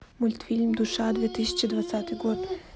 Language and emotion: Russian, neutral